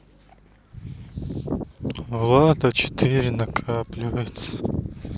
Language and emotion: Russian, sad